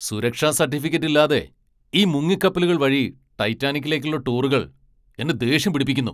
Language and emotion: Malayalam, angry